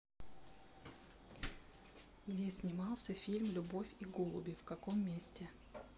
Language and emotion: Russian, neutral